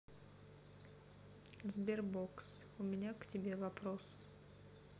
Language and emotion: Russian, sad